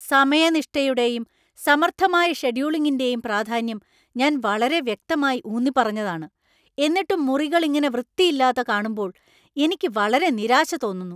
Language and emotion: Malayalam, angry